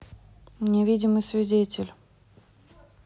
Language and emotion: Russian, neutral